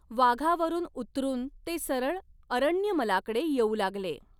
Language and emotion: Marathi, neutral